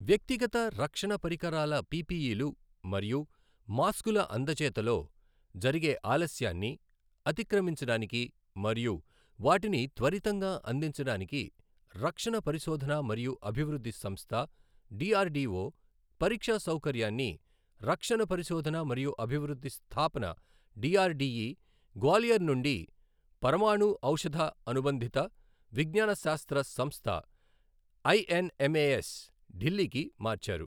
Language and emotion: Telugu, neutral